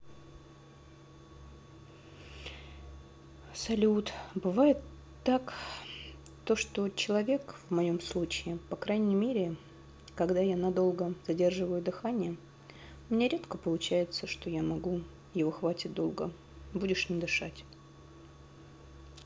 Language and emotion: Russian, sad